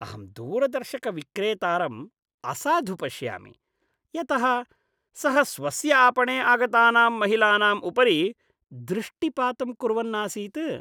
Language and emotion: Sanskrit, disgusted